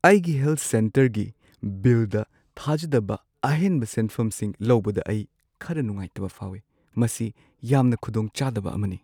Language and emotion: Manipuri, sad